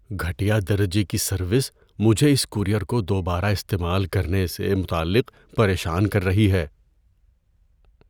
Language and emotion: Urdu, fearful